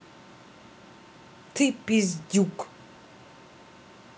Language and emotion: Russian, angry